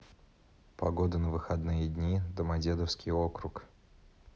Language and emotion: Russian, neutral